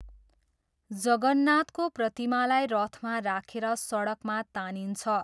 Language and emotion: Nepali, neutral